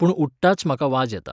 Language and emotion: Goan Konkani, neutral